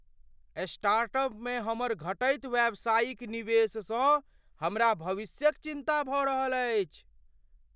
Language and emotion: Maithili, fearful